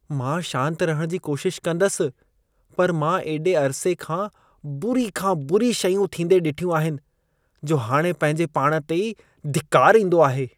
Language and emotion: Sindhi, disgusted